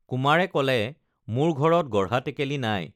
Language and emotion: Assamese, neutral